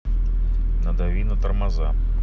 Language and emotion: Russian, neutral